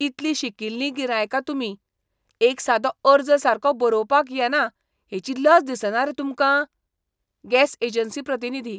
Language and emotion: Goan Konkani, disgusted